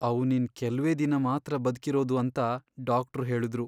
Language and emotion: Kannada, sad